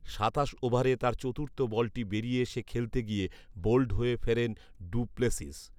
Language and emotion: Bengali, neutral